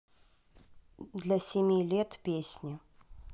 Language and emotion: Russian, neutral